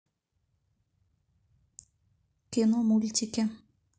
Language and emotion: Russian, neutral